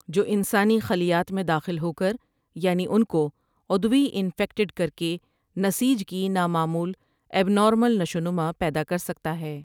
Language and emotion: Urdu, neutral